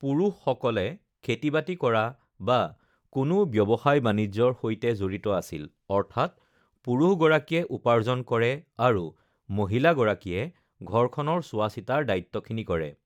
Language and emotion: Assamese, neutral